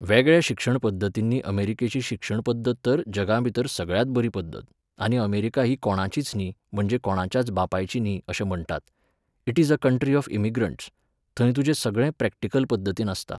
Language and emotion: Goan Konkani, neutral